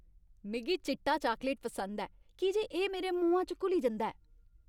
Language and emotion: Dogri, happy